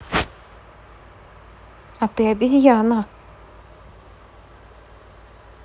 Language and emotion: Russian, neutral